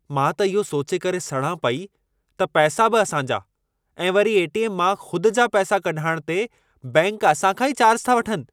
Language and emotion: Sindhi, angry